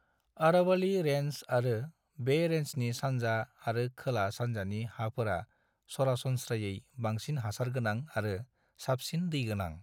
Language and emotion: Bodo, neutral